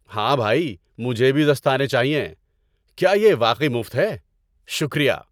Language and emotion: Urdu, happy